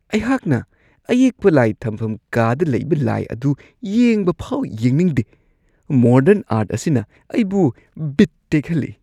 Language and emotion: Manipuri, disgusted